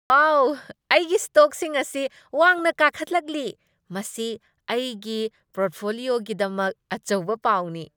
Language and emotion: Manipuri, happy